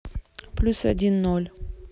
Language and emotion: Russian, neutral